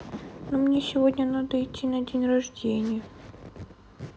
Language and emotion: Russian, sad